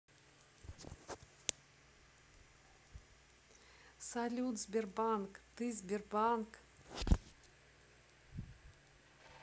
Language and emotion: Russian, positive